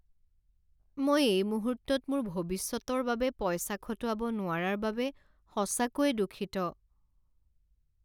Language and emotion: Assamese, sad